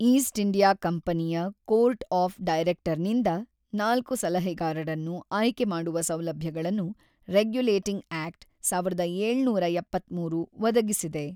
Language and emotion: Kannada, neutral